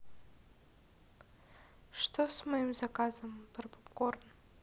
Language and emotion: Russian, sad